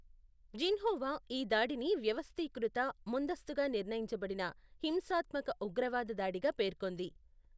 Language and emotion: Telugu, neutral